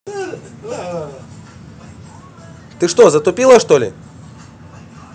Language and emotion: Russian, angry